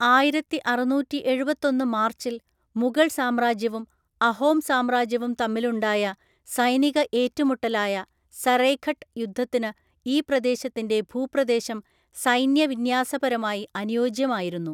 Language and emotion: Malayalam, neutral